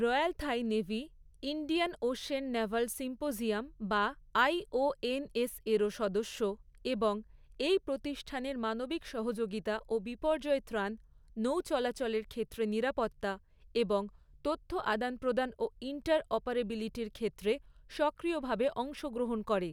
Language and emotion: Bengali, neutral